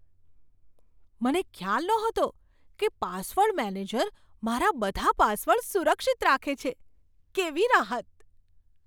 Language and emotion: Gujarati, surprised